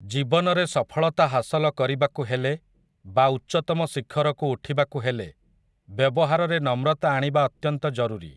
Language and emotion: Odia, neutral